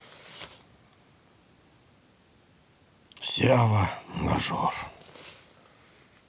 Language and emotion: Russian, sad